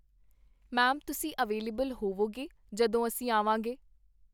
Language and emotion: Punjabi, neutral